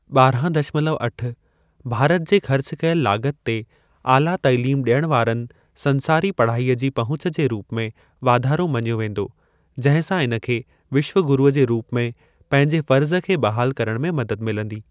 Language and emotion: Sindhi, neutral